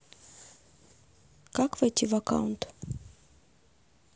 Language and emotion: Russian, neutral